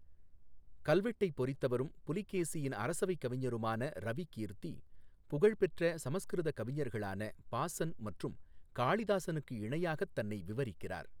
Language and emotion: Tamil, neutral